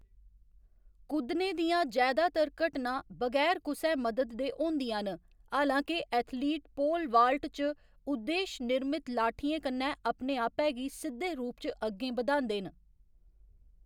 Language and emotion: Dogri, neutral